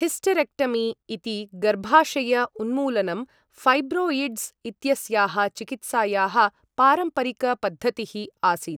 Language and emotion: Sanskrit, neutral